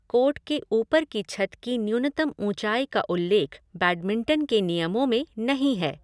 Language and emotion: Hindi, neutral